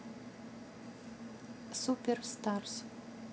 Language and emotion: Russian, neutral